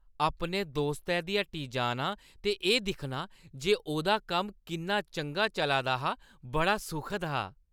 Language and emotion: Dogri, happy